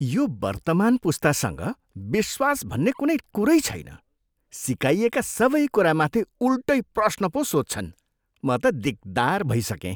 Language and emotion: Nepali, disgusted